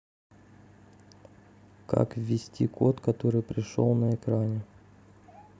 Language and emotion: Russian, neutral